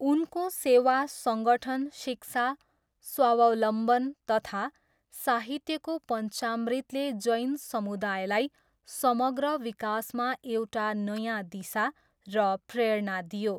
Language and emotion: Nepali, neutral